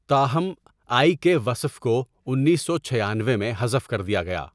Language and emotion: Urdu, neutral